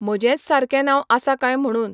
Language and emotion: Goan Konkani, neutral